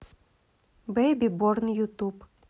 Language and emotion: Russian, neutral